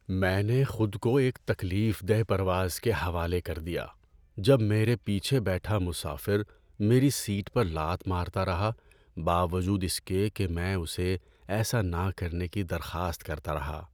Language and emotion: Urdu, sad